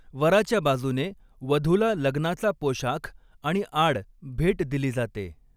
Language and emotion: Marathi, neutral